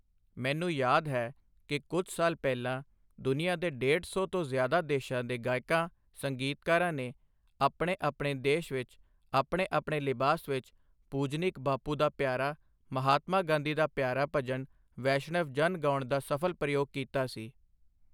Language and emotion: Punjabi, neutral